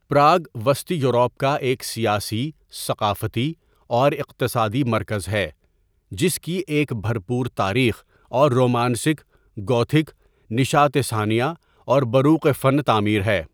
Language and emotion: Urdu, neutral